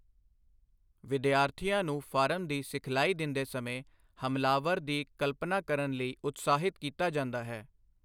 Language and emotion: Punjabi, neutral